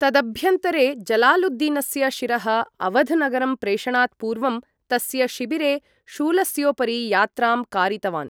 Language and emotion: Sanskrit, neutral